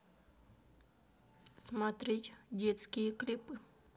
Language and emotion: Russian, neutral